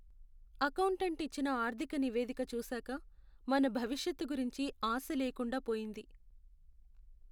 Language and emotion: Telugu, sad